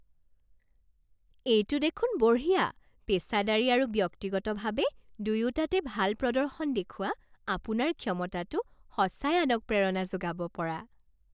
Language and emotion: Assamese, happy